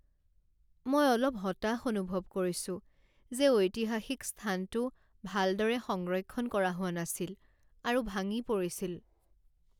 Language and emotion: Assamese, sad